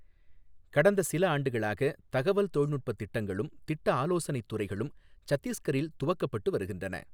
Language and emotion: Tamil, neutral